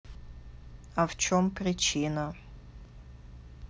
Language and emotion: Russian, neutral